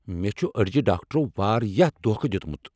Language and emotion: Kashmiri, angry